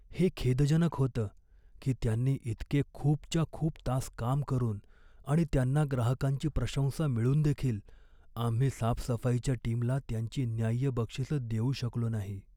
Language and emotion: Marathi, sad